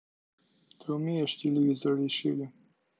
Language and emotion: Russian, neutral